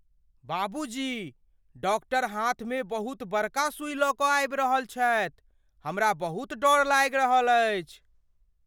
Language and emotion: Maithili, fearful